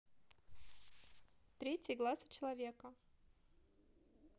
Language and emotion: Russian, neutral